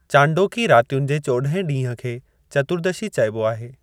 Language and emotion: Sindhi, neutral